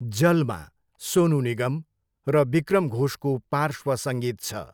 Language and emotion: Nepali, neutral